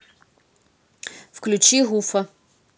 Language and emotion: Russian, neutral